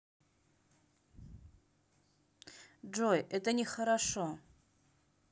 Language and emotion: Russian, neutral